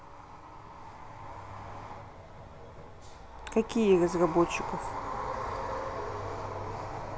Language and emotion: Russian, neutral